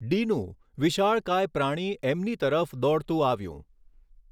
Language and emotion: Gujarati, neutral